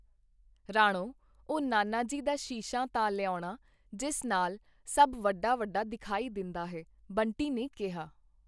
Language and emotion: Punjabi, neutral